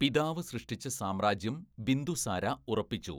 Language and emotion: Malayalam, neutral